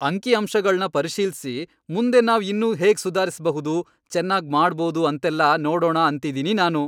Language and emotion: Kannada, happy